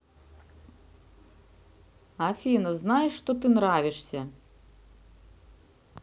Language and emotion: Russian, neutral